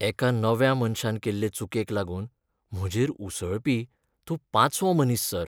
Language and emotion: Goan Konkani, sad